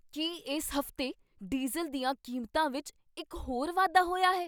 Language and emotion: Punjabi, surprised